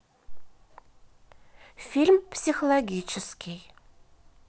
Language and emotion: Russian, neutral